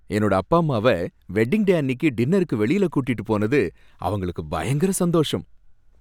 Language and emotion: Tamil, happy